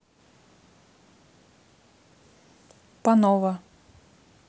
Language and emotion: Russian, neutral